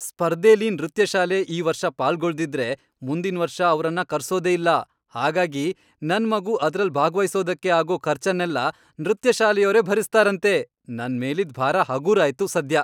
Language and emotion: Kannada, happy